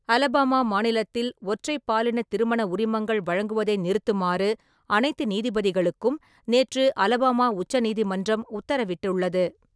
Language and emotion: Tamil, neutral